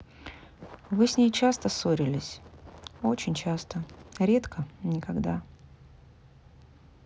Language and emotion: Russian, sad